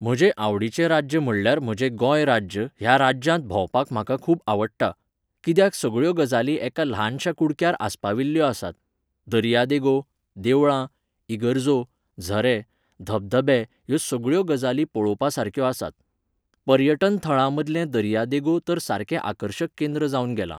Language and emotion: Goan Konkani, neutral